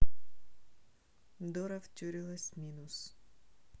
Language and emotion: Russian, neutral